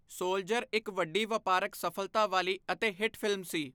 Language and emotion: Punjabi, neutral